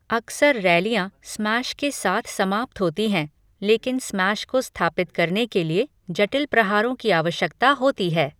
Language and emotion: Hindi, neutral